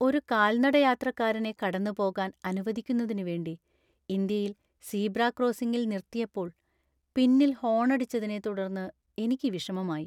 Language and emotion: Malayalam, sad